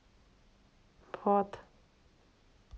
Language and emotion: Russian, neutral